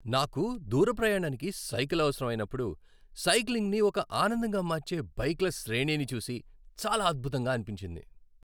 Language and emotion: Telugu, happy